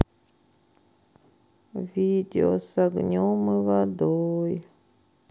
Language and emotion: Russian, sad